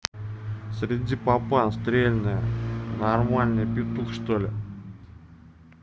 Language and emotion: Russian, neutral